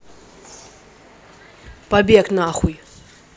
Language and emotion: Russian, angry